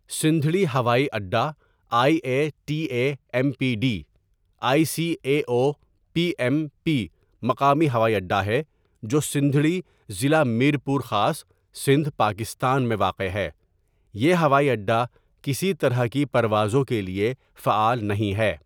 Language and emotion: Urdu, neutral